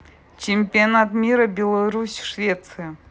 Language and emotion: Russian, neutral